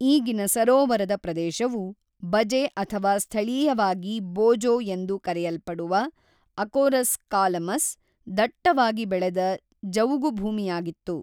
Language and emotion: Kannada, neutral